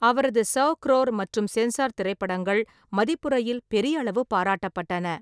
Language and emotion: Tamil, neutral